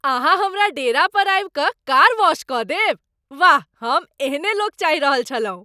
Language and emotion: Maithili, happy